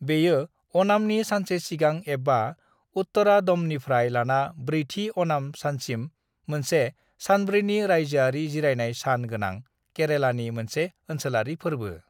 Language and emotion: Bodo, neutral